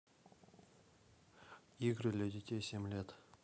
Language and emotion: Russian, neutral